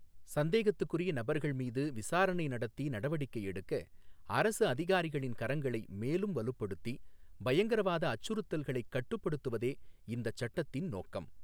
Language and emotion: Tamil, neutral